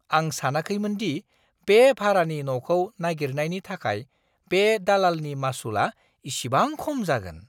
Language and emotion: Bodo, surprised